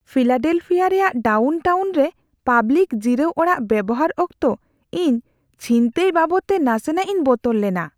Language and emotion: Santali, fearful